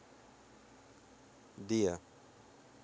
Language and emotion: Russian, neutral